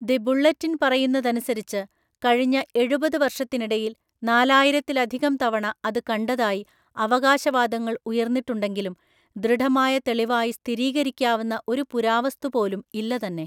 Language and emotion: Malayalam, neutral